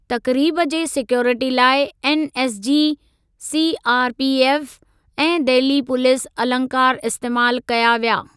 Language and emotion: Sindhi, neutral